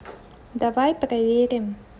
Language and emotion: Russian, neutral